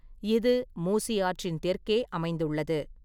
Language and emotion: Tamil, neutral